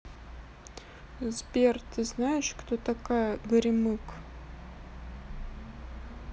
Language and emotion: Russian, neutral